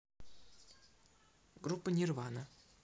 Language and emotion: Russian, neutral